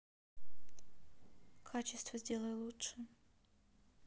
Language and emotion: Russian, neutral